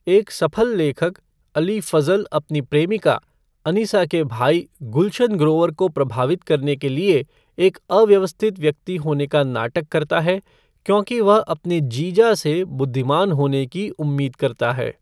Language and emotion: Hindi, neutral